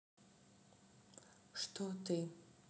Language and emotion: Russian, neutral